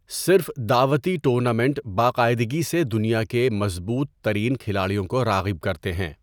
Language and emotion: Urdu, neutral